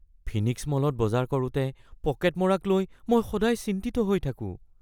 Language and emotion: Assamese, fearful